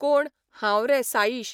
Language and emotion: Goan Konkani, neutral